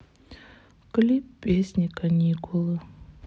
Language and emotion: Russian, sad